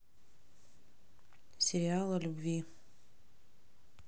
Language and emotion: Russian, neutral